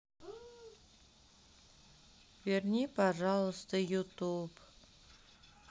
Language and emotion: Russian, sad